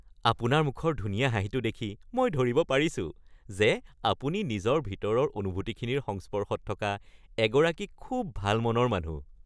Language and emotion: Assamese, happy